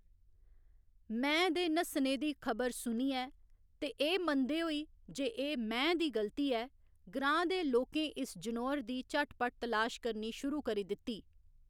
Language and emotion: Dogri, neutral